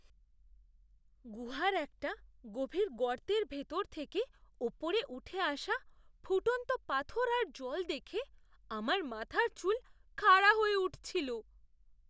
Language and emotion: Bengali, fearful